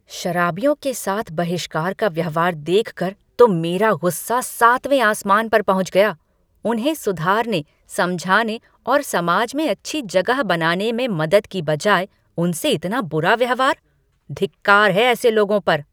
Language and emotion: Hindi, angry